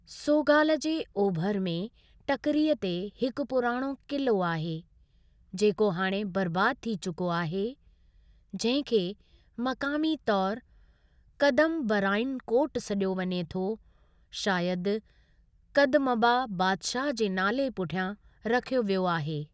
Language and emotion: Sindhi, neutral